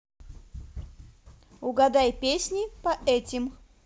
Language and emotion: Russian, positive